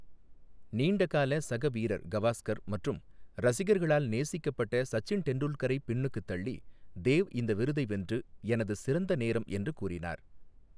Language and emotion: Tamil, neutral